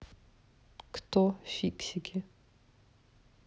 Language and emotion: Russian, neutral